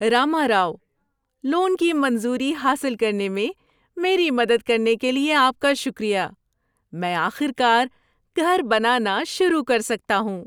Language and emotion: Urdu, happy